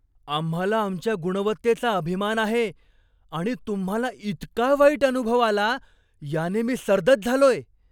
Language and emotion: Marathi, surprised